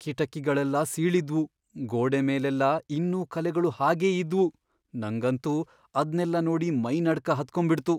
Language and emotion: Kannada, fearful